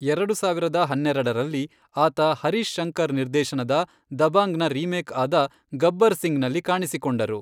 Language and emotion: Kannada, neutral